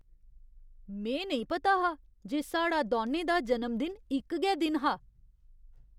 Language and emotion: Dogri, surprised